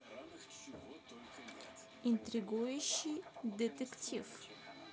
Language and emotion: Russian, neutral